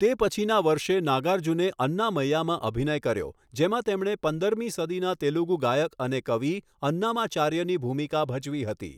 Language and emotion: Gujarati, neutral